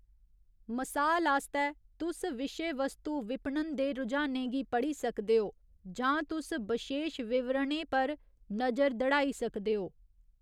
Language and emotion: Dogri, neutral